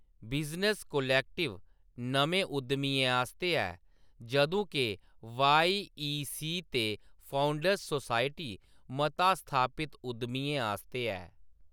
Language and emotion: Dogri, neutral